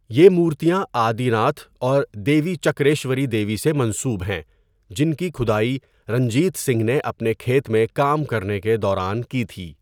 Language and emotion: Urdu, neutral